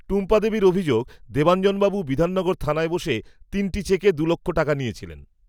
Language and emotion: Bengali, neutral